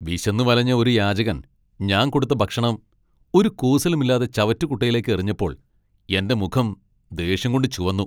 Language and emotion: Malayalam, angry